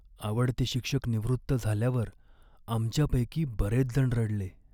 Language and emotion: Marathi, sad